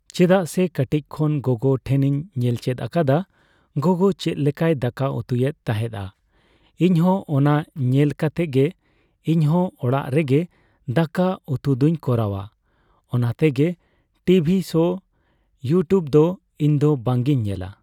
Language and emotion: Santali, neutral